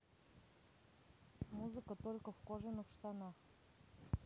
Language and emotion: Russian, neutral